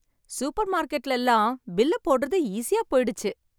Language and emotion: Tamil, happy